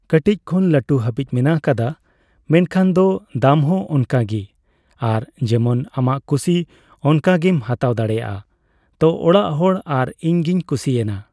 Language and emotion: Santali, neutral